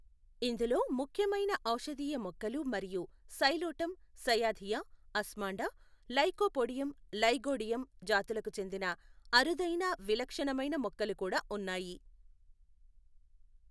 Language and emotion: Telugu, neutral